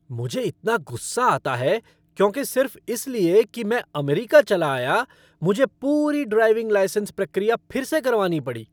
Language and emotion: Hindi, angry